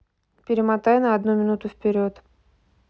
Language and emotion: Russian, neutral